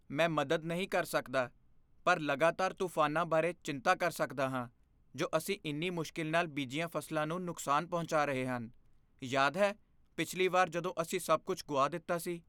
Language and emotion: Punjabi, fearful